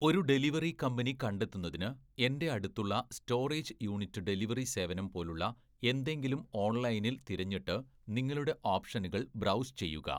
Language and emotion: Malayalam, neutral